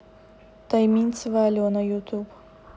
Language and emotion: Russian, neutral